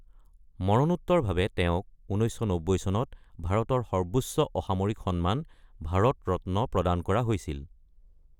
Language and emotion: Assamese, neutral